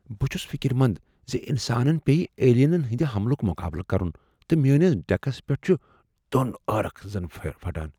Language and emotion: Kashmiri, fearful